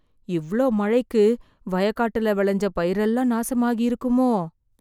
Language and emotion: Tamil, fearful